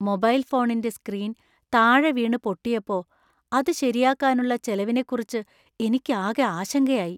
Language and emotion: Malayalam, fearful